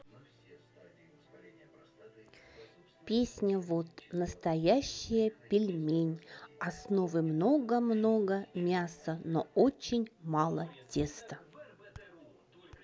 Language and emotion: Russian, neutral